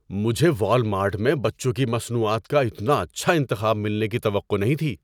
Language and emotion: Urdu, surprised